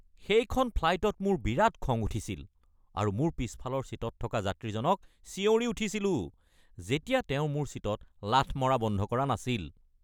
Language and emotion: Assamese, angry